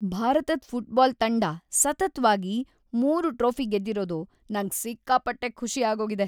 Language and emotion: Kannada, happy